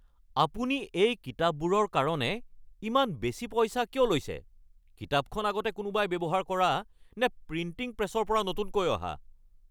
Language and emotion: Assamese, angry